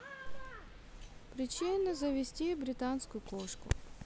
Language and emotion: Russian, neutral